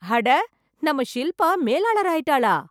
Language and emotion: Tamil, surprised